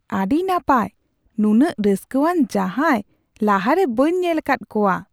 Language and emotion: Santali, surprised